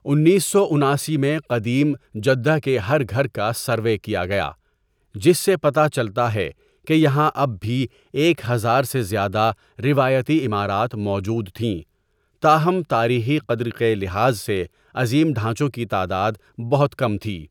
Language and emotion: Urdu, neutral